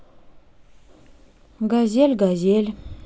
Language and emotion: Russian, neutral